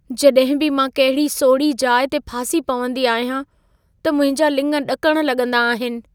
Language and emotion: Sindhi, fearful